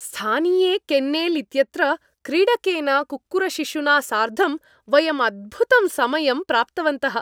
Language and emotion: Sanskrit, happy